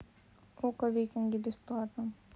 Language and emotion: Russian, neutral